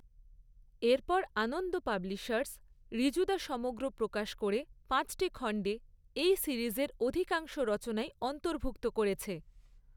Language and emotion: Bengali, neutral